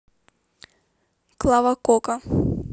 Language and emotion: Russian, neutral